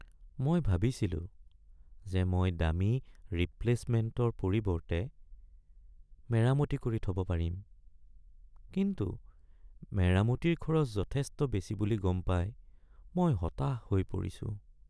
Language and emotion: Assamese, sad